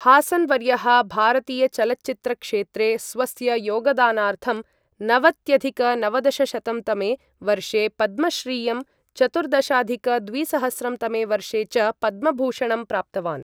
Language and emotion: Sanskrit, neutral